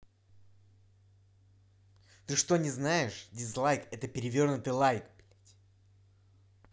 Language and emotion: Russian, angry